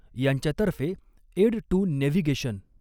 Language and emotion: Marathi, neutral